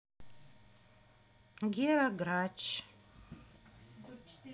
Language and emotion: Russian, neutral